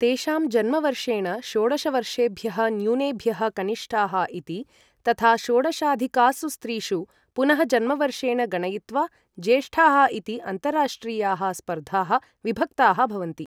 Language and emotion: Sanskrit, neutral